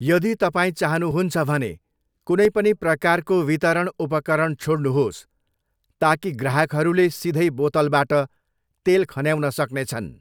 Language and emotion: Nepali, neutral